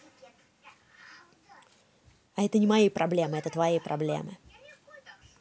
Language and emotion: Russian, angry